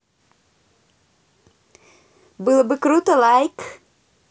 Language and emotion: Russian, positive